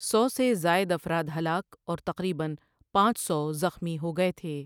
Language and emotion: Urdu, neutral